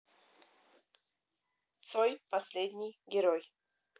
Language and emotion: Russian, positive